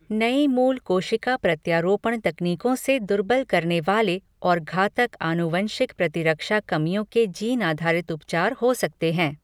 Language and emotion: Hindi, neutral